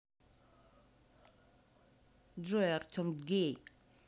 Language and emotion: Russian, angry